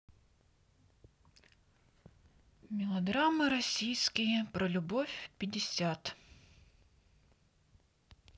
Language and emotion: Russian, sad